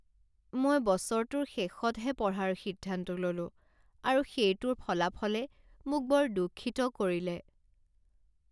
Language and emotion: Assamese, sad